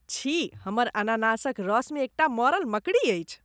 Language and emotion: Maithili, disgusted